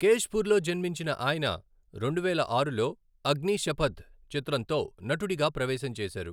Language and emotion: Telugu, neutral